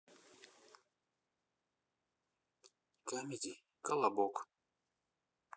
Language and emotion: Russian, neutral